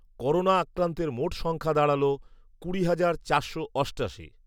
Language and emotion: Bengali, neutral